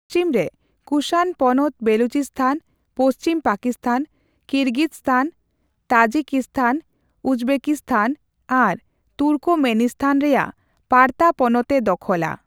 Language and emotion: Santali, neutral